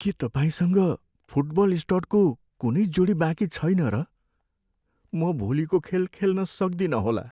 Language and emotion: Nepali, sad